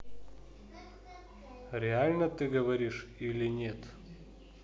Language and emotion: Russian, neutral